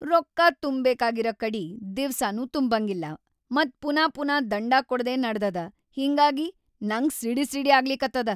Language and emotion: Kannada, angry